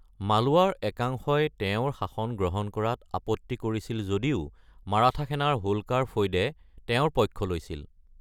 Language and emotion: Assamese, neutral